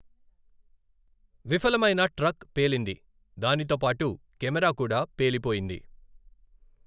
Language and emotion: Telugu, neutral